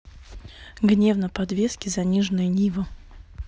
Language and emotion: Russian, neutral